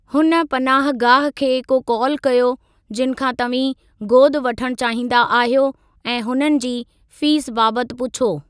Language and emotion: Sindhi, neutral